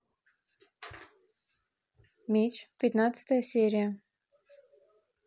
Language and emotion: Russian, neutral